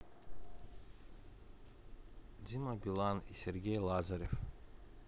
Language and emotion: Russian, neutral